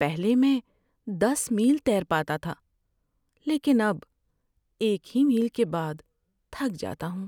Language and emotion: Urdu, sad